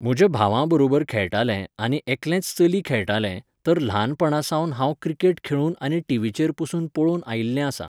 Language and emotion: Goan Konkani, neutral